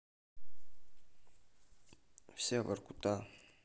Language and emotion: Russian, neutral